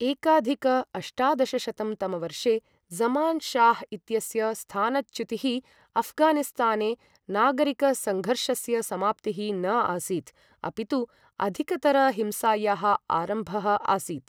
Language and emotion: Sanskrit, neutral